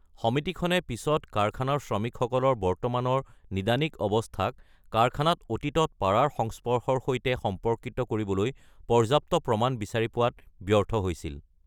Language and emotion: Assamese, neutral